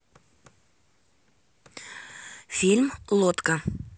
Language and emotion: Russian, neutral